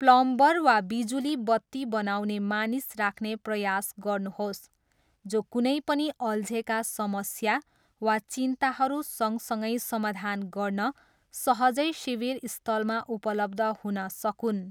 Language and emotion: Nepali, neutral